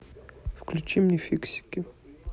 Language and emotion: Russian, neutral